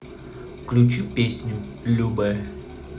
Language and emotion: Russian, neutral